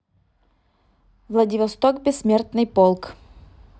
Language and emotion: Russian, neutral